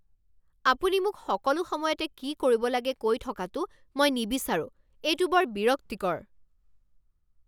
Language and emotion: Assamese, angry